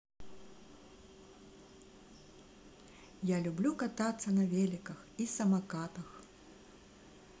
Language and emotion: Russian, positive